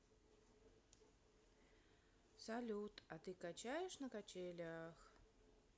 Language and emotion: Russian, neutral